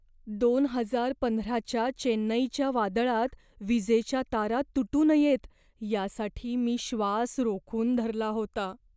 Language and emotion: Marathi, fearful